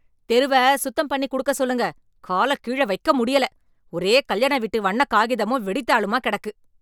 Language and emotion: Tamil, angry